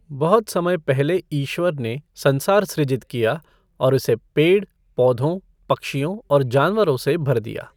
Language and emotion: Hindi, neutral